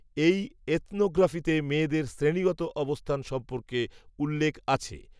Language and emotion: Bengali, neutral